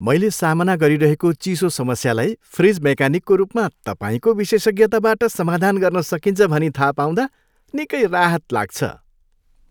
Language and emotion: Nepali, happy